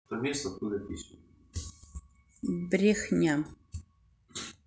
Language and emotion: Russian, neutral